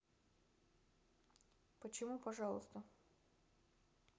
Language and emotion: Russian, neutral